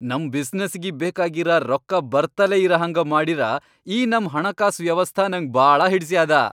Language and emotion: Kannada, happy